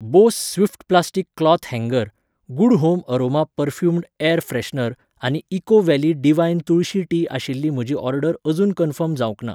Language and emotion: Goan Konkani, neutral